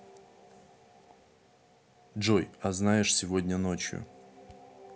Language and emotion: Russian, neutral